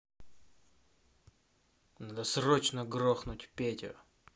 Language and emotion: Russian, angry